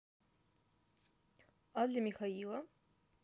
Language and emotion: Russian, neutral